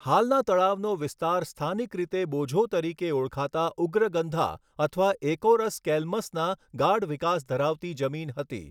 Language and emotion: Gujarati, neutral